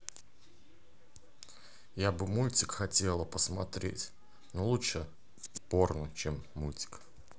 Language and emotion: Russian, neutral